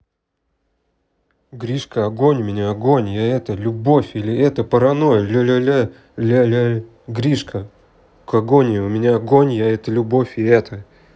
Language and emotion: Russian, neutral